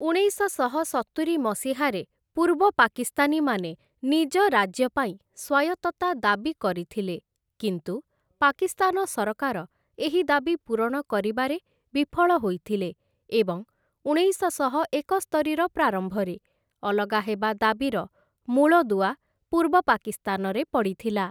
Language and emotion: Odia, neutral